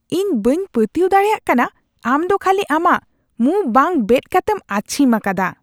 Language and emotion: Santali, disgusted